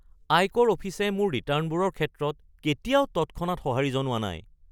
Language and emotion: Assamese, surprised